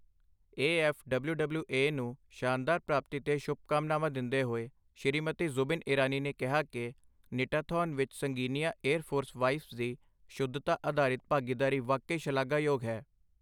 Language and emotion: Punjabi, neutral